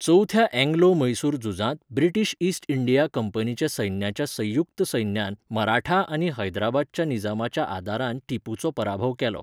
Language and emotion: Goan Konkani, neutral